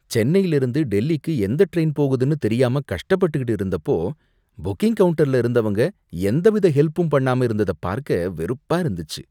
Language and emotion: Tamil, disgusted